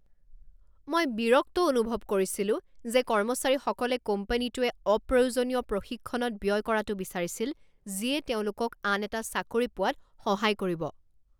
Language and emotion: Assamese, angry